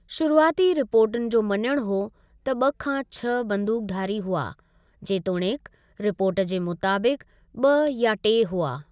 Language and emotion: Sindhi, neutral